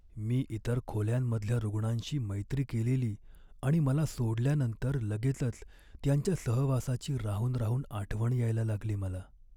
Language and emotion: Marathi, sad